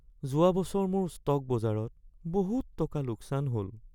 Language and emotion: Assamese, sad